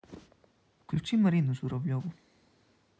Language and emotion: Russian, neutral